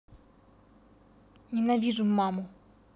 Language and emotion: Russian, angry